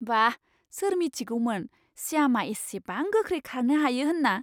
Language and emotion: Bodo, surprised